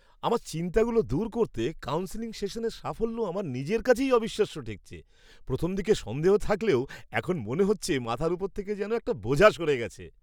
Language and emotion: Bengali, surprised